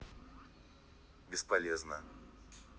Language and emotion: Russian, neutral